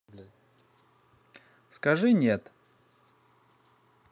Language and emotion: Russian, neutral